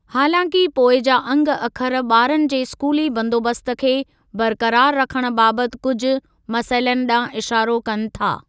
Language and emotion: Sindhi, neutral